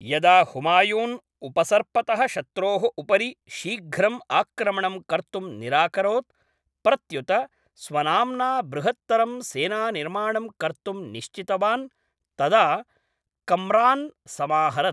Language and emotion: Sanskrit, neutral